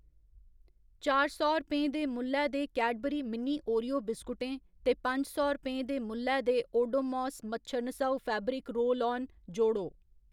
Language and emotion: Dogri, neutral